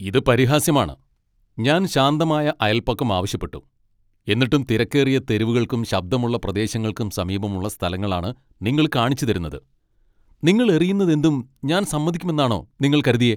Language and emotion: Malayalam, angry